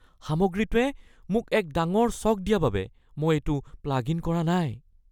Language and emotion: Assamese, fearful